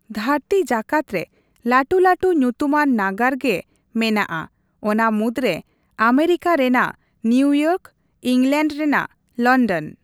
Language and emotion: Santali, neutral